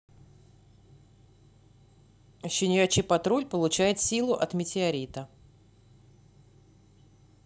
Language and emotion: Russian, neutral